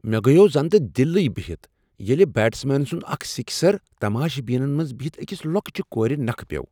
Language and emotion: Kashmiri, surprised